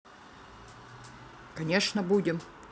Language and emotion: Russian, neutral